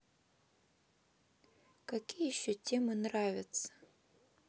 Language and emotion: Russian, neutral